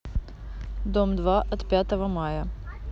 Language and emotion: Russian, neutral